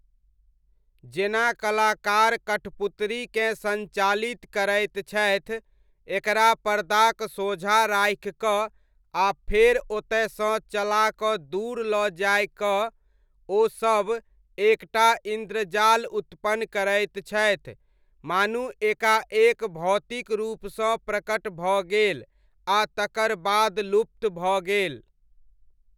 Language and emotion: Maithili, neutral